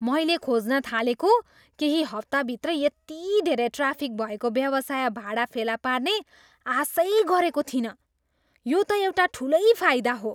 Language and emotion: Nepali, surprised